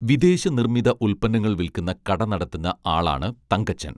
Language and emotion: Malayalam, neutral